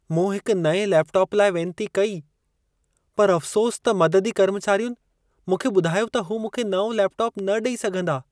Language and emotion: Sindhi, sad